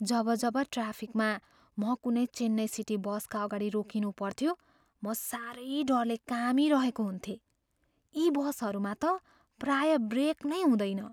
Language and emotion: Nepali, fearful